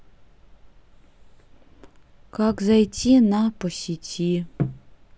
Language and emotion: Russian, neutral